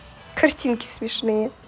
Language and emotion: Russian, positive